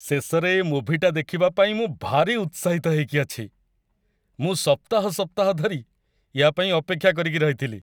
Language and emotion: Odia, happy